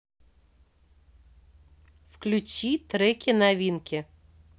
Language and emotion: Russian, neutral